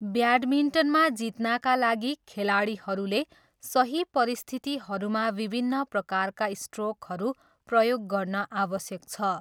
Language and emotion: Nepali, neutral